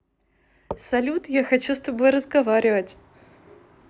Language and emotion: Russian, positive